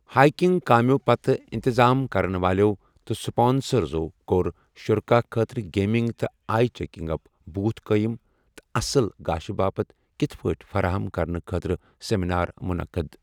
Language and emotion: Kashmiri, neutral